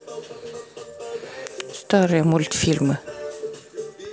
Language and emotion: Russian, neutral